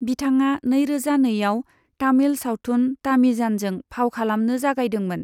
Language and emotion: Bodo, neutral